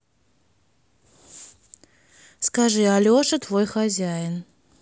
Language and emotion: Russian, neutral